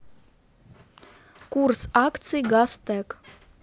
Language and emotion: Russian, neutral